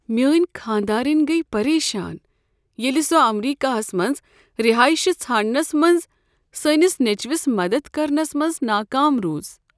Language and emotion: Kashmiri, sad